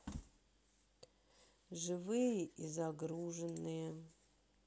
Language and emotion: Russian, sad